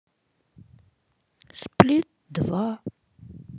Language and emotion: Russian, sad